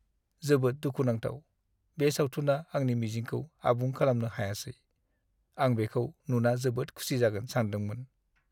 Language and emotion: Bodo, sad